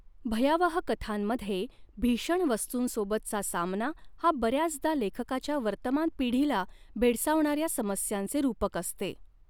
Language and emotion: Marathi, neutral